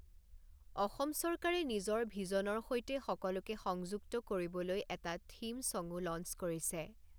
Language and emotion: Assamese, neutral